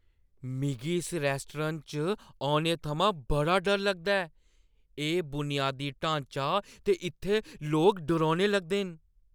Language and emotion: Dogri, fearful